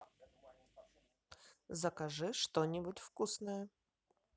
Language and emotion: Russian, positive